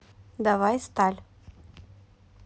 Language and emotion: Russian, neutral